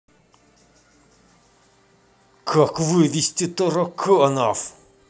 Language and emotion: Russian, angry